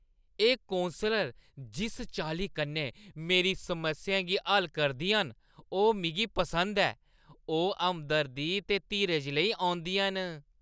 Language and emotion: Dogri, happy